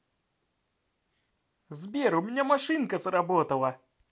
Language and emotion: Russian, positive